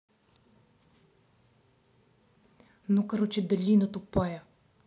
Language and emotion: Russian, angry